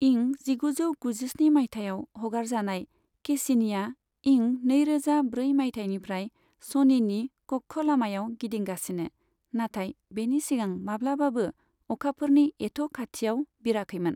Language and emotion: Bodo, neutral